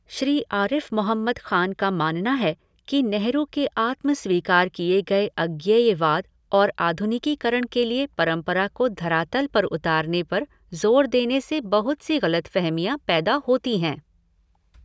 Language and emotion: Hindi, neutral